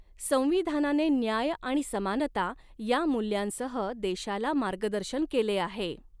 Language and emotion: Marathi, neutral